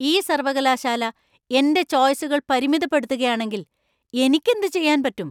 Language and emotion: Malayalam, angry